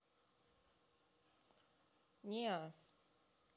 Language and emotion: Russian, neutral